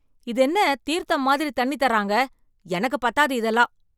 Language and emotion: Tamil, angry